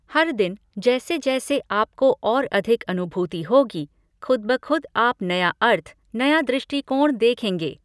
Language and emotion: Hindi, neutral